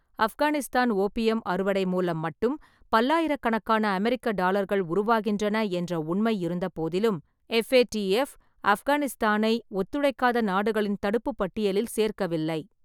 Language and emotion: Tamil, neutral